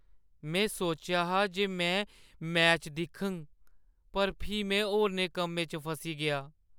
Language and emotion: Dogri, sad